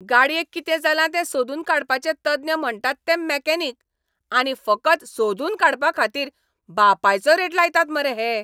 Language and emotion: Goan Konkani, angry